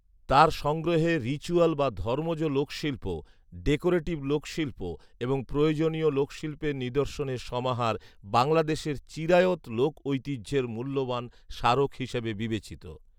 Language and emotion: Bengali, neutral